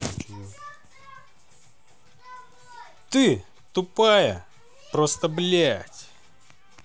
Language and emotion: Russian, angry